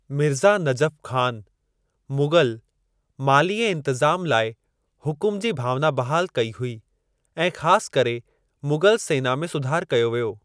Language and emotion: Sindhi, neutral